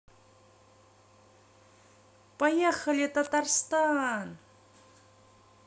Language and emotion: Russian, positive